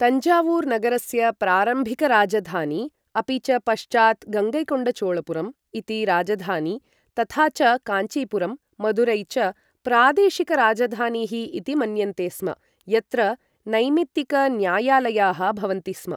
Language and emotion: Sanskrit, neutral